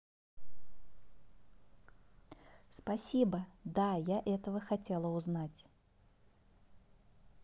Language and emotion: Russian, positive